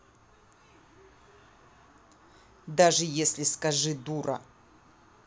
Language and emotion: Russian, angry